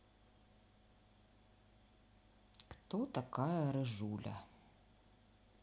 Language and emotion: Russian, neutral